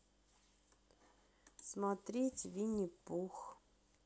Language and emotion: Russian, sad